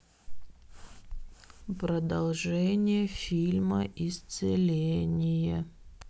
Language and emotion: Russian, sad